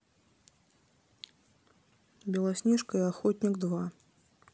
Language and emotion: Russian, neutral